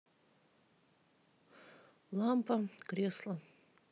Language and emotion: Russian, neutral